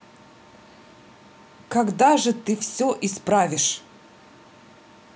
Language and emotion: Russian, angry